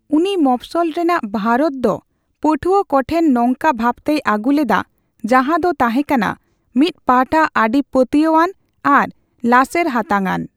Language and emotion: Santali, neutral